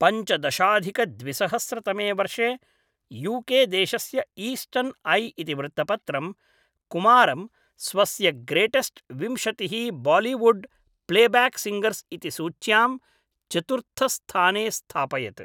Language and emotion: Sanskrit, neutral